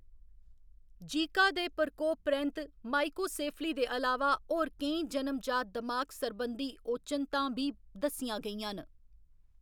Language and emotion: Dogri, neutral